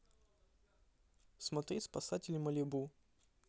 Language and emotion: Russian, neutral